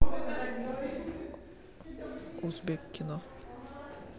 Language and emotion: Russian, neutral